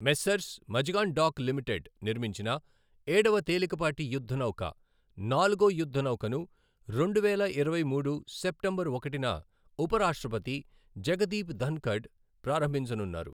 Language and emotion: Telugu, neutral